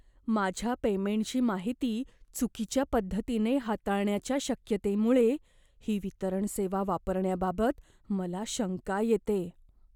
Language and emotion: Marathi, fearful